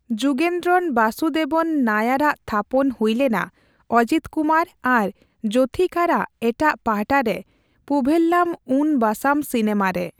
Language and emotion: Santali, neutral